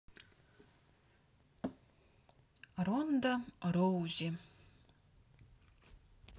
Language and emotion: Russian, neutral